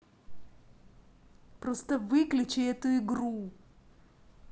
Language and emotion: Russian, angry